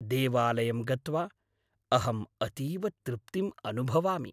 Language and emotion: Sanskrit, happy